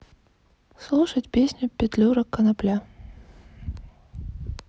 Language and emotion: Russian, sad